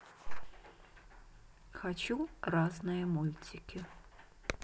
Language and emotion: Russian, neutral